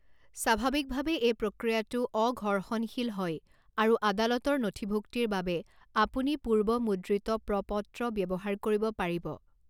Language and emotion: Assamese, neutral